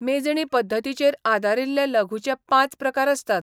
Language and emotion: Goan Konkani, neutral